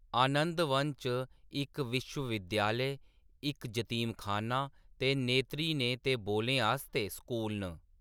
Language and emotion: Dogri, neutral